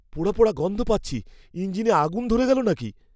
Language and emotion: Bengali, fearful